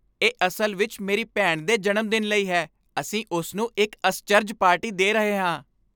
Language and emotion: Punjabi, happy